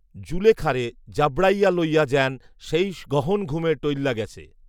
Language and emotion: Bengali, neutral